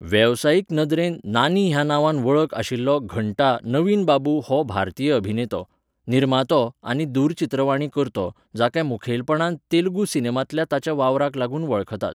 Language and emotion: Goan Konkani, neutral